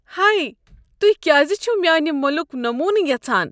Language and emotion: Kashmiri, disgusted